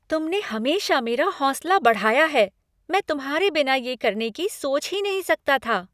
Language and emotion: Hindi, happy